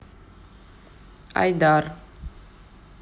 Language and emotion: Russian, neutral